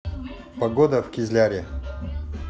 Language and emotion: Russian, neutral